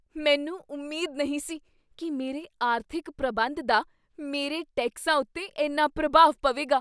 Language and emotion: Punjabi, surprised